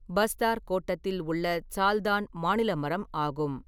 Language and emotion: Tamil, neutral